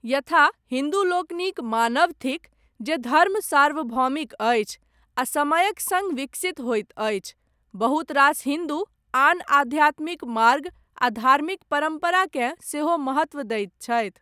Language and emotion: Maithili, neutral